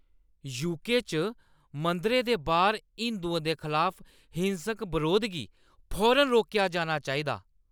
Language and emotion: Dogri, angry